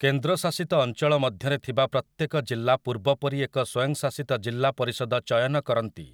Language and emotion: Odia, neutral